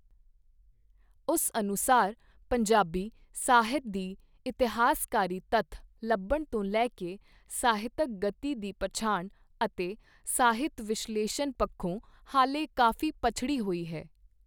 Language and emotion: Punjabi, neutral